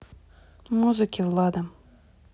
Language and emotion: Russian, neutral